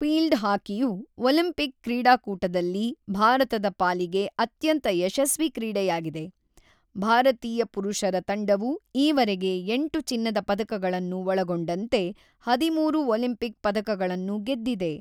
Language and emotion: Kannada, neutral